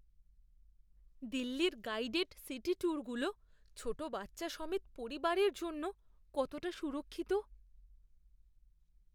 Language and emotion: Bengali, fearful